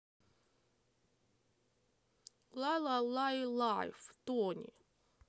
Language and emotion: Russian, neutral